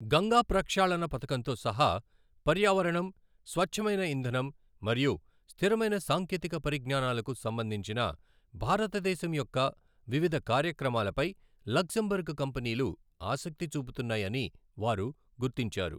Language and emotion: Telugu, neutral